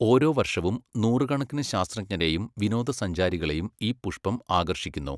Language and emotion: Malayalam, neutral